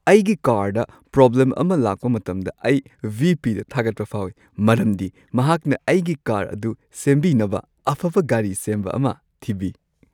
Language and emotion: Manipuri, happy